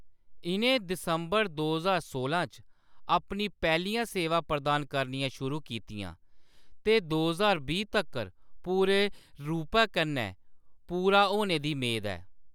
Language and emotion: Dogri, neutral